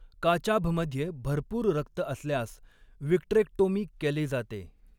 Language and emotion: Marathi, neutral